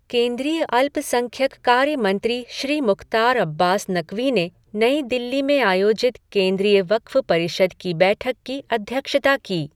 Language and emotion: Hindi, neutral